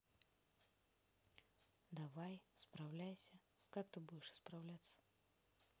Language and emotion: Russian, neutral